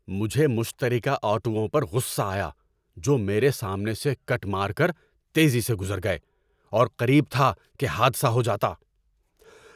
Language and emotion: Urdu, angry